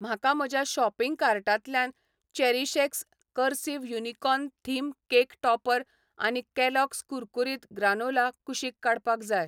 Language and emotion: Goan Konkani, neutral